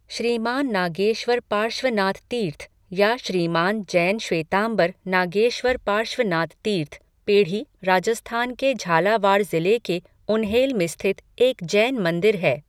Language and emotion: Hindi, neutral